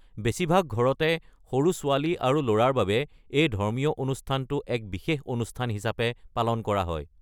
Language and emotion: Assamese, neutral